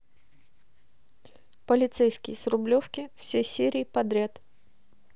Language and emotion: Russian, neutral